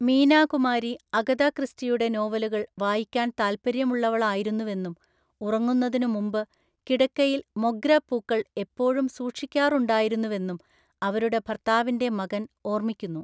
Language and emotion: Malayalam, neutral